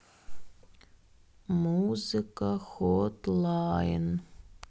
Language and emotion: Russian, sad